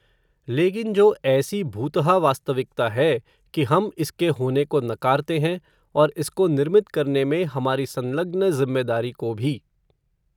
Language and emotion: Hindi, neutral